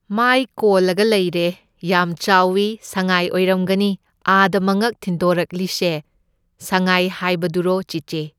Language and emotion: Manipuri, neutral